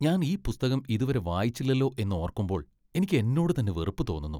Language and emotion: Malayalam, disgusted